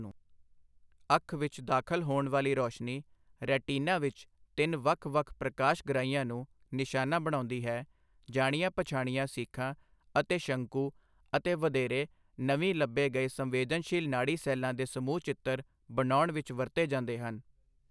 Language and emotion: Punjabi, neutral